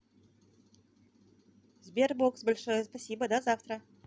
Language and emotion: Russian, positive